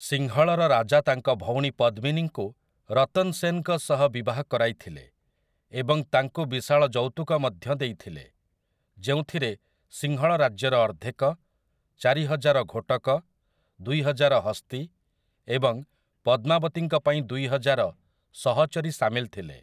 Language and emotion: Odia, neutral